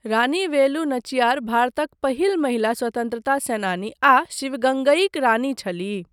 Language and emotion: Maithili, neutral